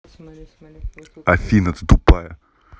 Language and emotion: Russian, angry